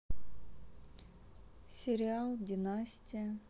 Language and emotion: Russian, sad